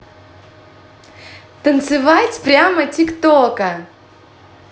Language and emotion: Russian, positive